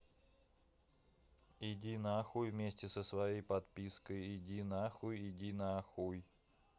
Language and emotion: Russian, neutral